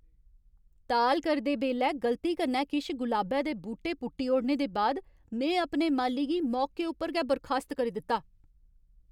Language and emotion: Dogri, angry